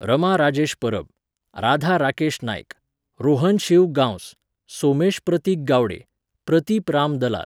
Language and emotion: Goan Konkani, neutral